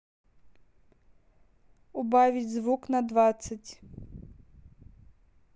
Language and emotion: Russian, neutral